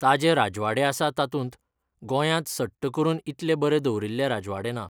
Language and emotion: Goan Konkani, neutral